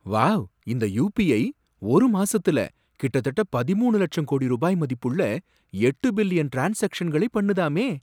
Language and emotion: Tamil, surprised